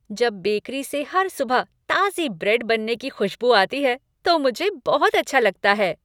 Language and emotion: Hindi, happy